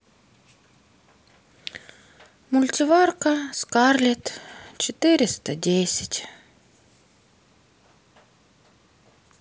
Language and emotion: Russian, sad